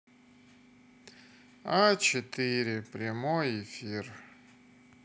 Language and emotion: Russian, sad